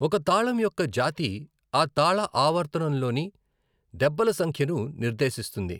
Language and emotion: Telugu, neutral